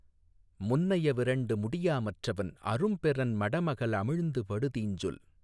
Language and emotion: Tamil, neutral